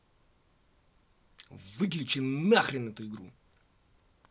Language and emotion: Russian, angry